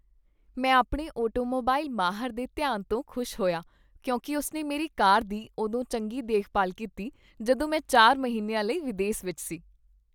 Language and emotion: Punjabi, happy